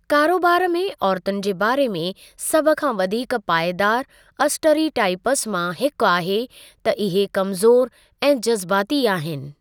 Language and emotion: Sindhi, neutral